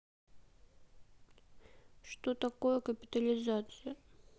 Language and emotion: Russian, sad